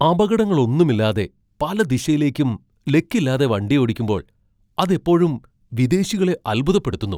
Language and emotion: Malayalam, surprised